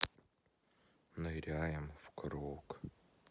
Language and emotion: Russian, sad